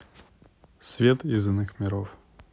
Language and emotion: Russian, neutral